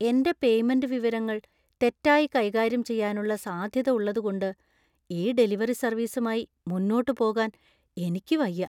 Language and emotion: Malayalam, fearful